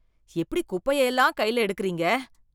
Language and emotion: Tamil, disgusted